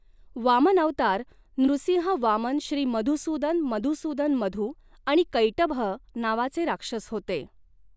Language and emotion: Marathi, neutral